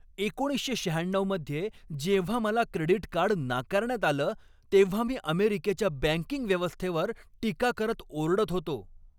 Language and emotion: Marathi, angry